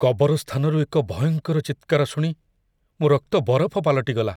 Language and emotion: Odia, fearful